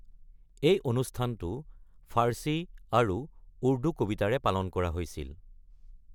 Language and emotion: Assamese, neutral